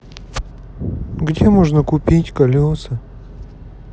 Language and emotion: Russian, sad